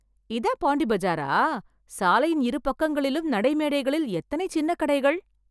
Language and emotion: Tamil, surprised